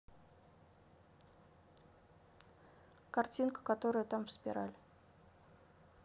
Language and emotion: Russian, neutral